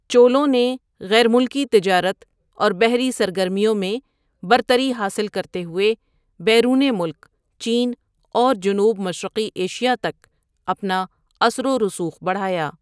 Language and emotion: Urdu, neutral